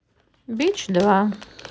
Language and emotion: Russian, neutral